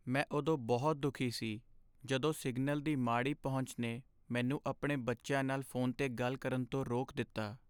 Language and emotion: Punjabi, sad